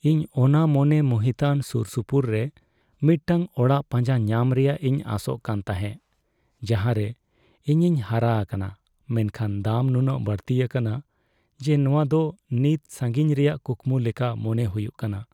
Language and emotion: Santali, sad